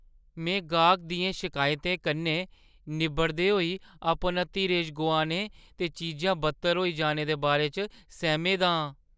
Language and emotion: Dogri, fearful